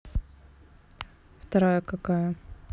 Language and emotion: Russian, neutral